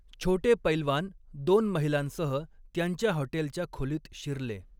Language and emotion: Marathi, neutral